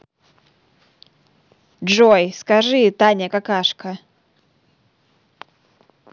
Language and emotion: Russian, neutral